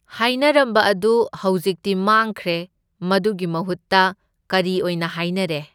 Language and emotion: Manipuri, neutral